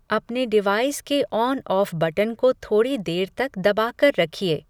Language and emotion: Hindi, neutral